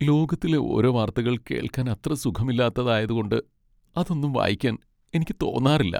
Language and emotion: Malayalam, sad